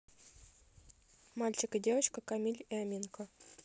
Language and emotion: Russian, neutral